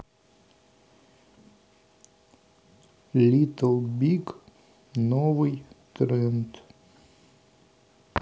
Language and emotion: Russian, neutral